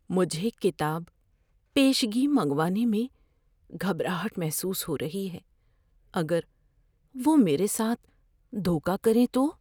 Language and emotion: Urdu, fearful